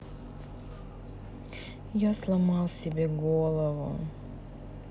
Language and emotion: Russian, sad